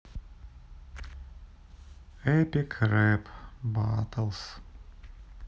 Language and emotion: Russian, sad